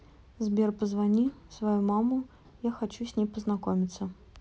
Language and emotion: Russian, neutral